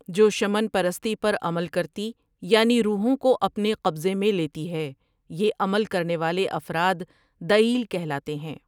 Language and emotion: Urdu, neutral